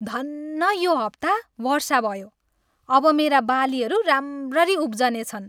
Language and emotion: Nepali, happy